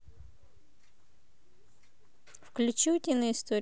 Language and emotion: Russian, neutral